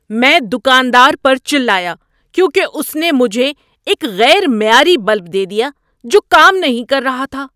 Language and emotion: Urdu, angry